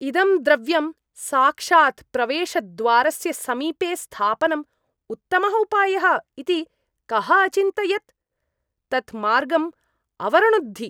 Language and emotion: Sanskrit, disgusted